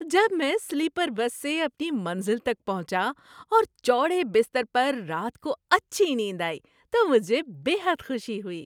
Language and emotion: Urdu, happy